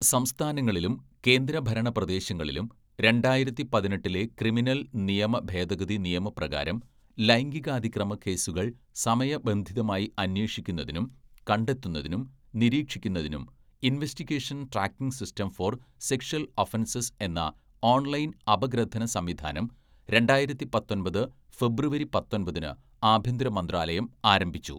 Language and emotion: Malayalam, neutral